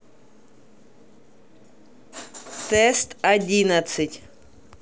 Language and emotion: Russian, neutral